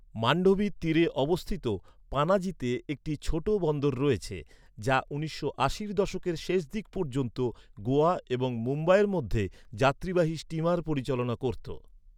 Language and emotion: Bengali, neutral